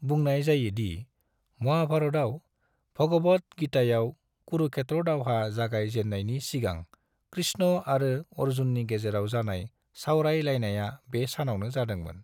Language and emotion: Bodo, neutral